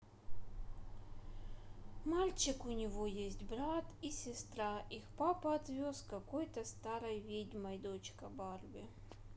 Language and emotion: Russian, neutral